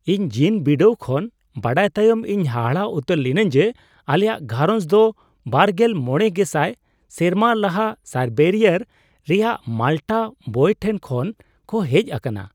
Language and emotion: Santali, surprised